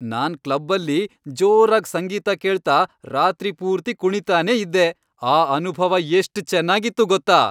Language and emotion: Kannada, happy